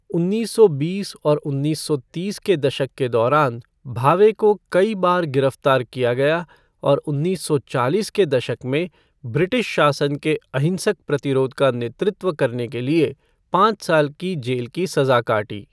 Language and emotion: Hindi, neutral